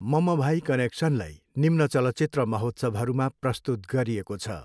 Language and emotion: Nepali, neutral